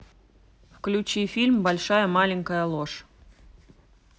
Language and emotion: Russian, neutral